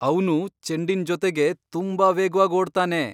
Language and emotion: Kannada, surprised